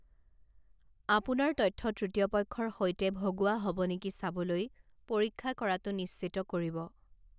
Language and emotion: Assamese, neutral